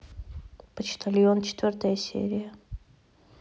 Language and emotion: Russian, neutral